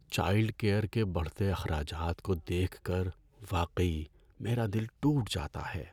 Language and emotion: Urdu, sad